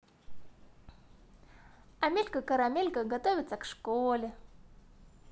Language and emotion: Russian, positive